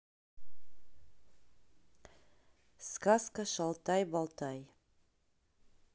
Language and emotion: Russian, neutral